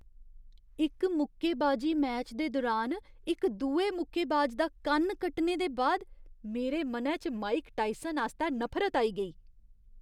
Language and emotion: Dogri, disgusted